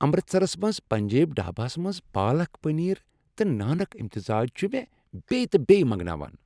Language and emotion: Kashmiri, happy